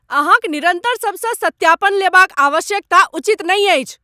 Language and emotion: Maithili, angry